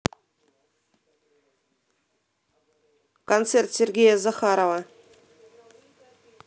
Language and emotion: Russian, neutral